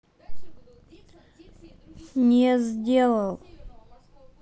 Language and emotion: Russian, neutral